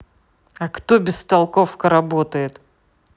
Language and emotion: Russian, angry